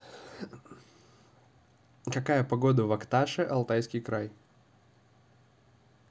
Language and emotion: Russian, neutral